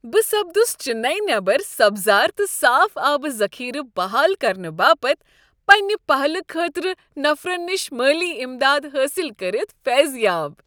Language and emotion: Kashmiri, happy